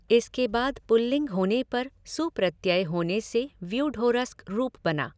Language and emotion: Hindi, neutral